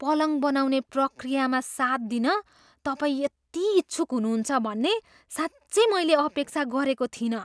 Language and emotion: Nepali, surprised